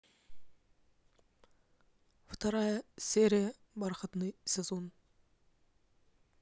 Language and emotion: Russian, neutral